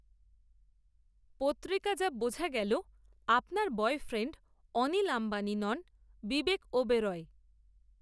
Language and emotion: Bengali, neutral